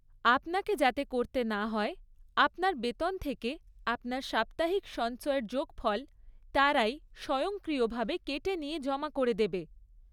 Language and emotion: Bengali, neutral